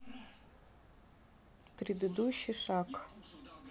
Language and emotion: Russian, neutral